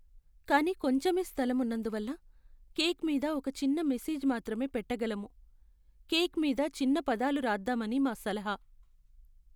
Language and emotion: Telugu, sad